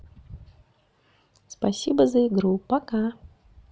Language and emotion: Russian, positive